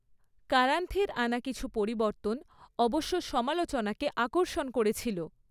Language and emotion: Bengali, neutral